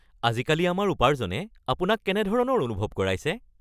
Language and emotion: Assamese, happy